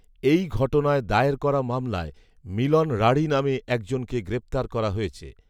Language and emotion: Bengali, neutral